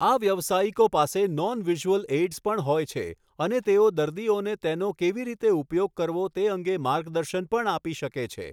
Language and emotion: Gujarati, neutral